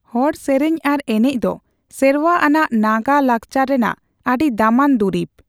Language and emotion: Santali, neutral